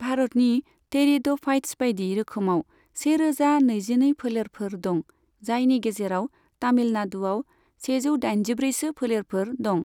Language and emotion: Bodo, neutral